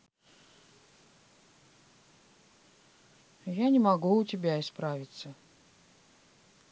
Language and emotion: Russian, neutral